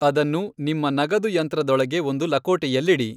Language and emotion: Kannada, neutral